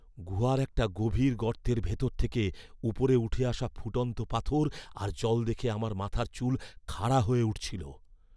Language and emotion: Bengali, fearful